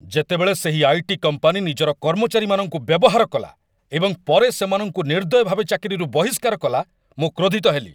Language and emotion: Odia, angry